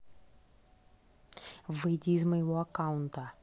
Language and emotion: Russian, angry